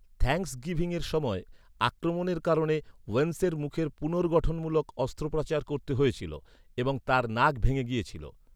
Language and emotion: Bengali, neutral